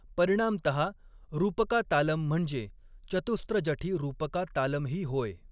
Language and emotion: Marathi, neutral